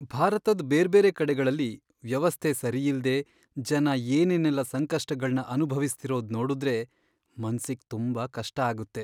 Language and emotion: Kannada, sad